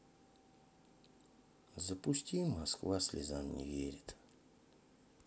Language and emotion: Russian, sad